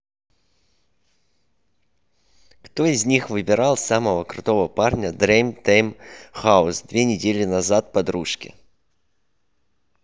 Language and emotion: Russian, neutral